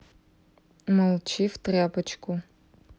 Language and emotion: Russian, neutral